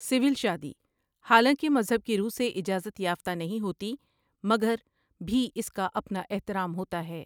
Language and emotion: Urdu, neutral